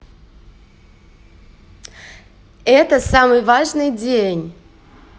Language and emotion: Russian, positive